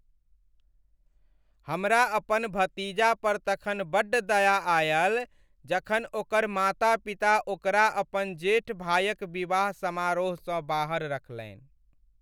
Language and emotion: Maithili, sad